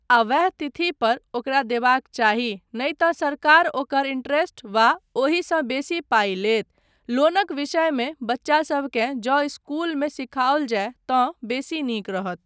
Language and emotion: Maithili, neutral